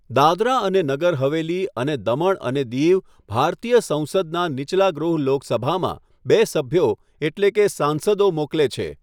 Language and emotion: Gujarati, neutral